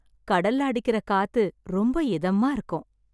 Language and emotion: Tamil, happy